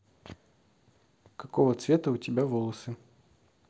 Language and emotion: Russian, neutral